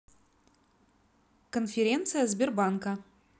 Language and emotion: Russian, neutral